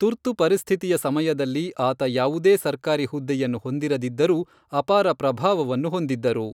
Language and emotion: Kannada, neutral